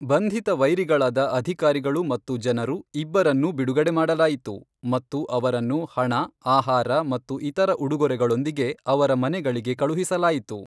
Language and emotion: Kannada, neutral